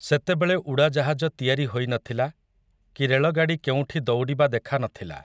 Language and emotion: Odia, neutral